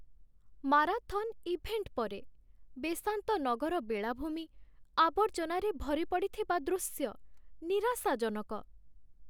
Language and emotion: Odia, sad